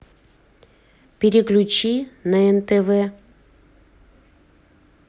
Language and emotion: Russian, neutral